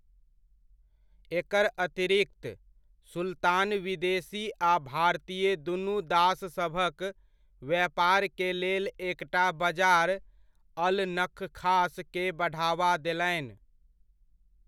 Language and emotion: Maithili, neutral